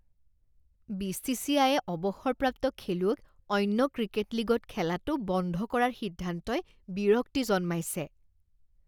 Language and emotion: Assamese, disgusted